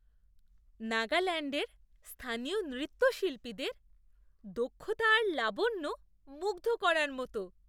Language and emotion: Bengali, surprised